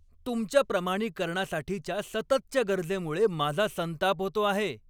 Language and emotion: Marathi, angry